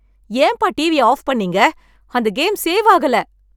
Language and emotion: Tamil, angry